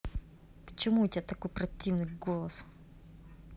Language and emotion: Russian, angry